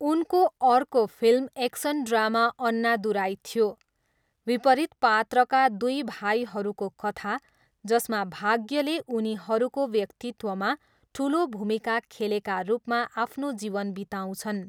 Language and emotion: Nepali, neutral